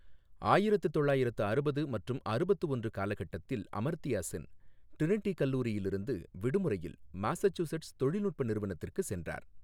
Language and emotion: Tamil, neutral